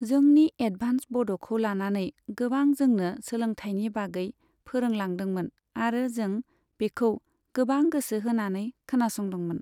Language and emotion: Bodo, neutral